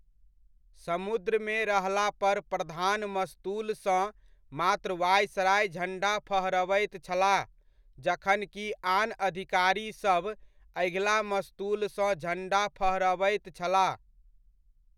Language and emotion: Maithili, neutral